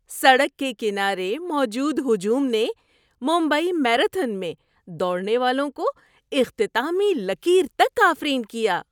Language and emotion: Urdu, happy